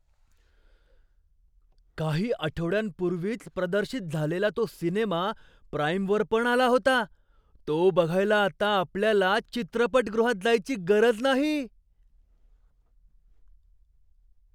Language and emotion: Marathi, surprised